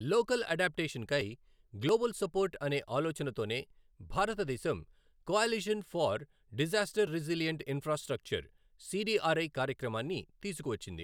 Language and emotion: Telugu, neutral